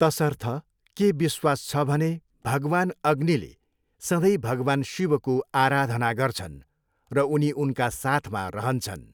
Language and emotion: Nepali, neutral